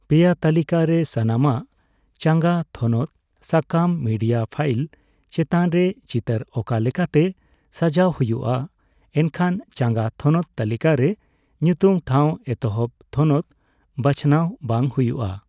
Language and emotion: Santali, neutral